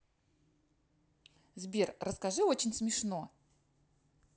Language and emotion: Russian, positive